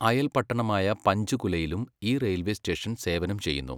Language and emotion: Malayalam, neutral